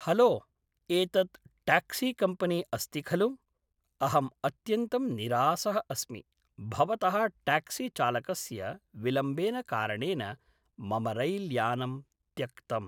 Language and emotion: Sanskrit, neutral